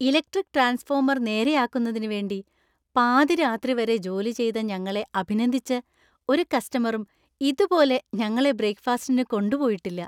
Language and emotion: Malayalam, happy